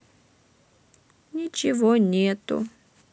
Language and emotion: Russian, sad